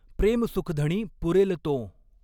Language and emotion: Marathi, neutral